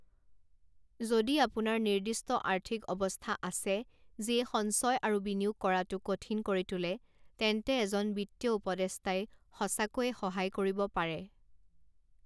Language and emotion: Assamese, neutral